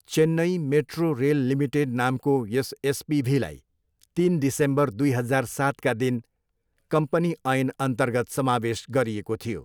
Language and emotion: Nepali, neutral